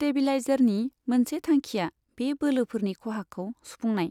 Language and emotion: Bodo, neutral